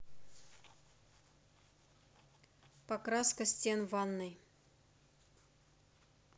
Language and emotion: Russian, neutral